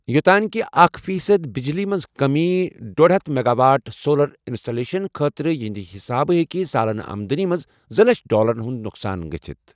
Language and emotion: Kashmiri, neutral